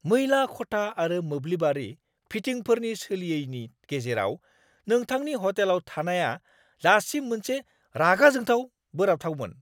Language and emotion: Bodo, angry